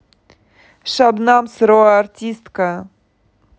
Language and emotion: Russian, neutral